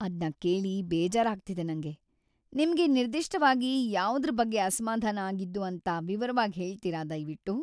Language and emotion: Kannada, sad